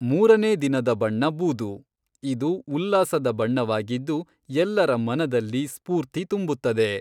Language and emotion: Kannada, neutral